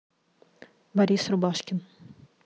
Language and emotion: Russian, neutral